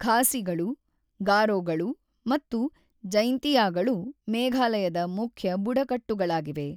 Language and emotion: Kannada, neutral